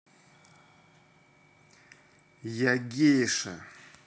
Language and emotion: Russian, neutral